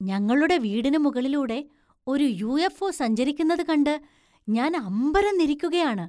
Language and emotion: Malayalam, surprised